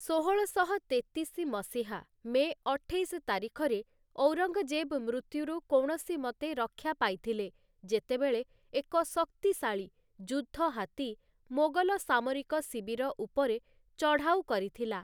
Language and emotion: Odia, neutral